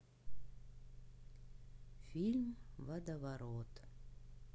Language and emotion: Russian, neutral